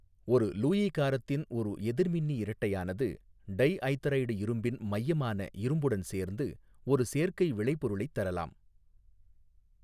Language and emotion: Tamil, neutral